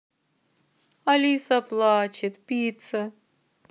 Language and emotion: Russian, sad